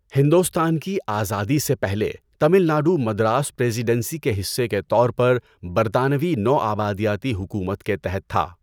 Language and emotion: Urdu, neutral